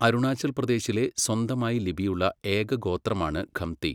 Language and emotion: Malayalam, neutral